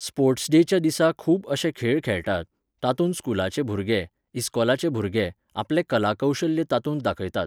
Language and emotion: Goan Konkani, neutral